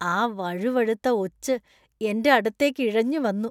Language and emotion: Malayalam, disgusted